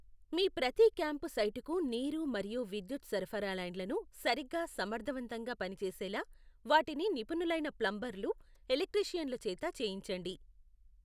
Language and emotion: Telugu, neutral